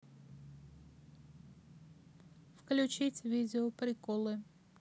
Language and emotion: Russian, neutral